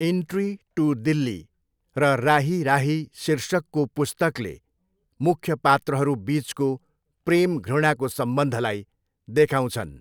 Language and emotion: Nepali, neutral